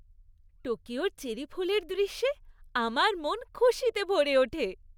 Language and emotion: Bengali, happy